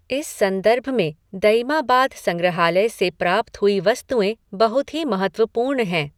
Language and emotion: Hindi, neutral